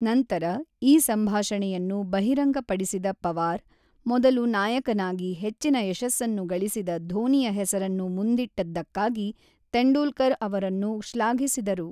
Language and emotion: Kannada, neutral